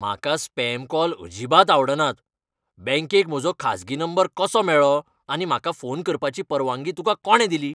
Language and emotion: Goan Konkani, angry